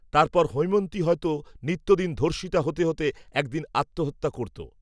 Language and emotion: Bengali, neutral